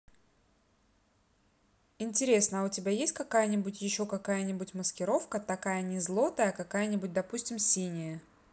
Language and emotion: Russian, neutral